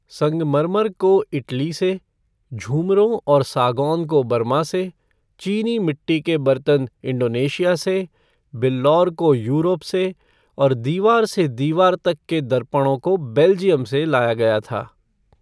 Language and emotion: Hindi, neutral